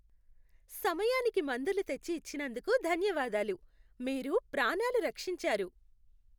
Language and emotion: Telugu, happy